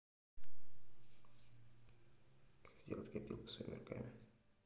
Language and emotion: Russian, neutral